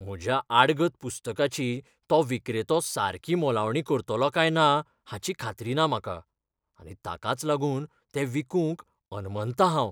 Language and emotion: Goan Konkani, fearful